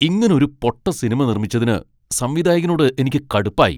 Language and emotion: Malayalam, angry